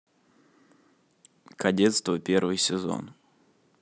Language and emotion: Russian, neutral